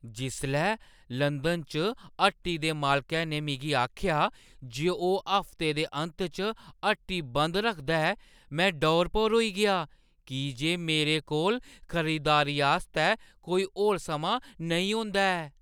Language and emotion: Dogri, surprised